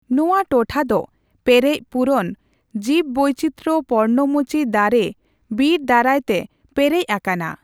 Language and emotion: Santali, neutral